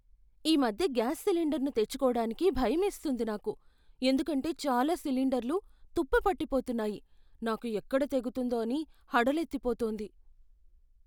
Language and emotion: Telugu, fearful